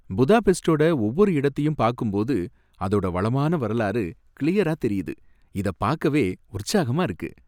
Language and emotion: Tamil, happy